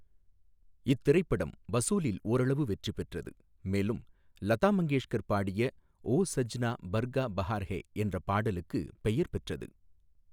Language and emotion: Tamil, neutral